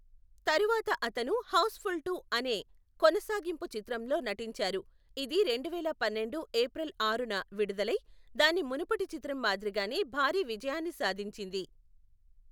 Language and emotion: Telugu, neutral